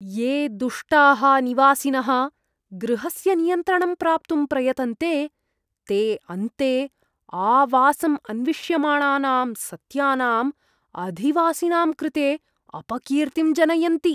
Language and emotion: Sanskrit, disgusted